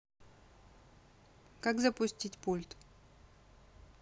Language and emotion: Russian, neutral